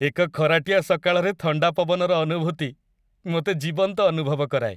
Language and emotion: Odia, happy